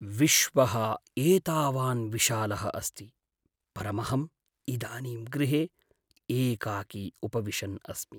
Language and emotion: Sanskrit, sad